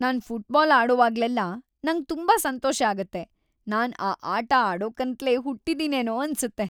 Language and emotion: Kannada, happy